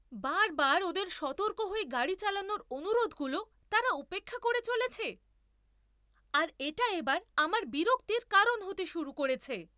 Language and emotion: Bengali, angry